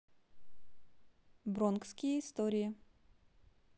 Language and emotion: Russian, neutral